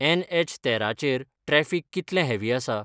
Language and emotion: Goan Konkani, neutral